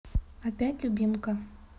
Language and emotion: Russian, neutral